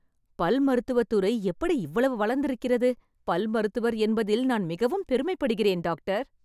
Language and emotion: Tamil, happy